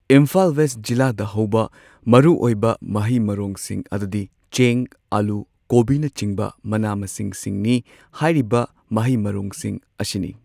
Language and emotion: Manipuri, neutral